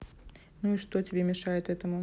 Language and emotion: Russian, neutral